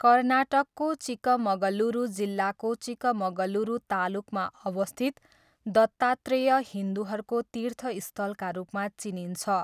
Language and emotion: Nepali, neutral